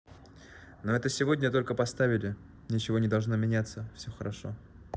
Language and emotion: Russian, neutral